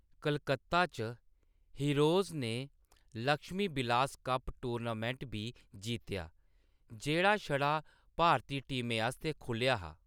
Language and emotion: Dogri, neutral